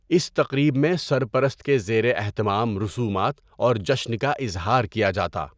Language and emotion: Urdu, neutral